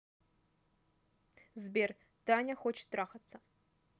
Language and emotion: Russian, neutral